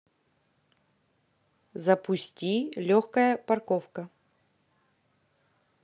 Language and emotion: Russian, neutral